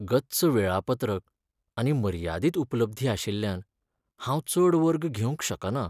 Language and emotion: Goan Konkani, sad